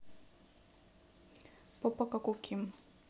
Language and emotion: Russian, neutral